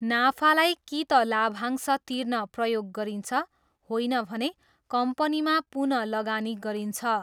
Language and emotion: Nepali, neutral